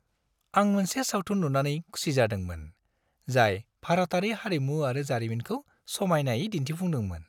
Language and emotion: Bodo, happy